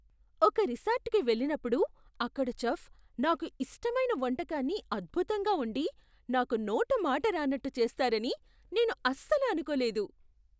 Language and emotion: Telugu, surprised